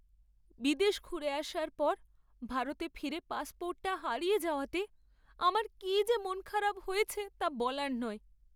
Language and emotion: Bengali, sad